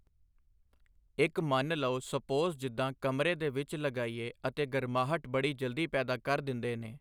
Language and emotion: Punjabi, neutral